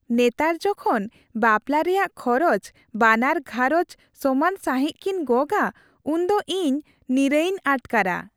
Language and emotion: Santali, happy